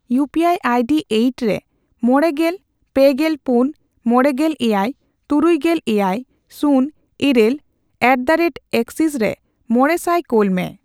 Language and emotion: Santali, neutral